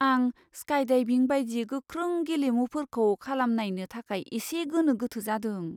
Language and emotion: Bodo, fearful